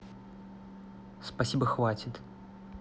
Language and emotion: Russian, neutral